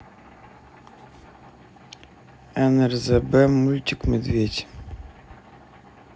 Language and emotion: Russian, neutral